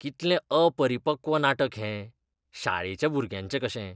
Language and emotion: Goan Konkani, disgusted